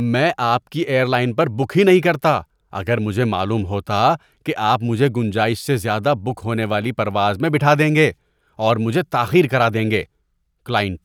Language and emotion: Urdu, disgusted